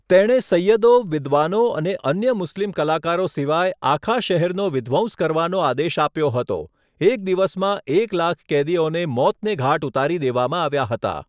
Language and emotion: Gujarati, neutral